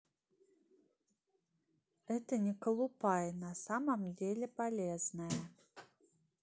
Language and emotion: Russian, neutral